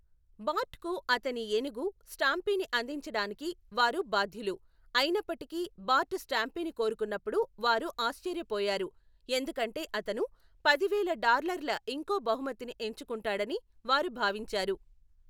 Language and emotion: Telugu, neutral